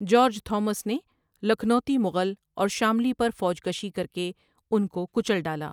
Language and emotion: Urdu, neutral